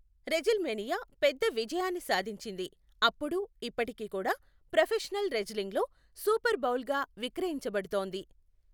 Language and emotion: Telugu, neutral